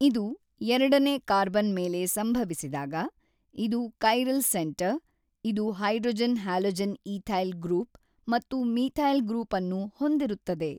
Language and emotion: Kannada, neutral